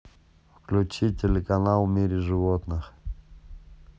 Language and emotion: Russian, neutral